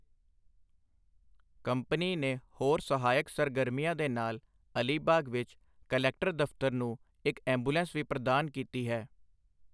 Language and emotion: Punjabi, neutral